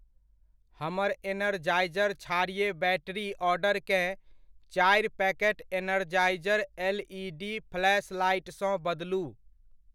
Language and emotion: Maithili, neutral